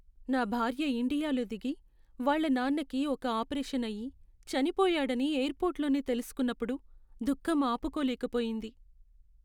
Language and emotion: Telugu, sad